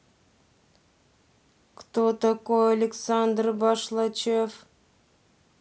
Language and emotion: Russian, neutral